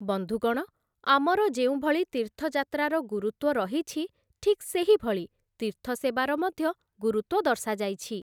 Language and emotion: Odia, neutral